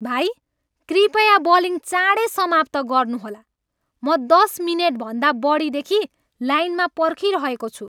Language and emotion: Nepali, angry